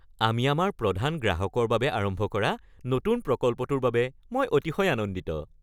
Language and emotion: Assamese, happy